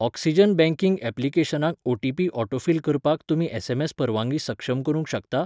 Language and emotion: Goan Konkani, neutral